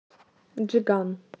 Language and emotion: Russian, neutral